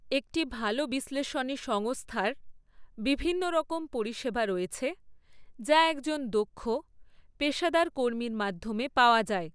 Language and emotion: Bengali, neutral